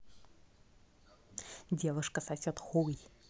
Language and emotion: Russian, neutral